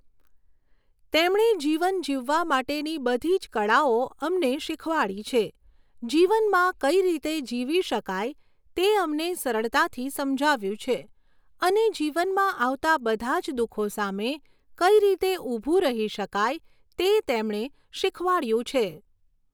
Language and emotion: Gujarati, neutral